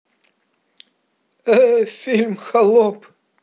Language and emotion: Russian, positive